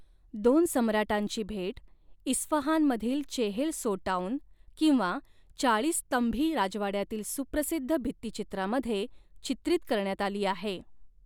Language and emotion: Marathi, neutral